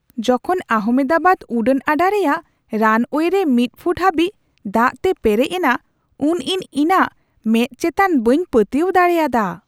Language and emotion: Santali, surprised